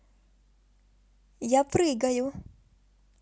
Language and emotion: Russian, positive